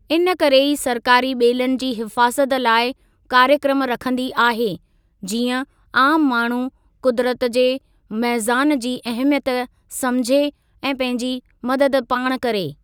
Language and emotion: Sindhi, neutral